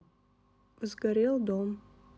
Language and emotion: Russian, neutral